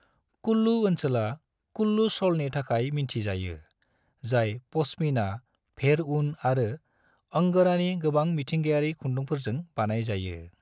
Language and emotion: Bodo, neutral